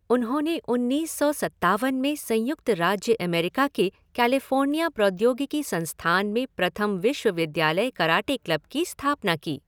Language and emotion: Hindi, neutral